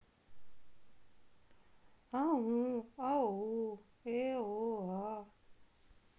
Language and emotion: Russian, sad